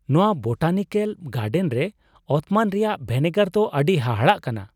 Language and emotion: Santali, surprised